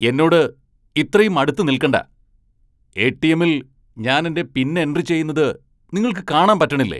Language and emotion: Malayalam, angry